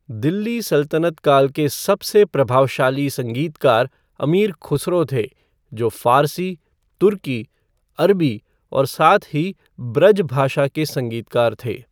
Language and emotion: Hindi, neutral